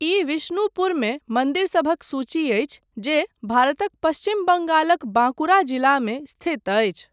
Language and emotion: Maithili, neutral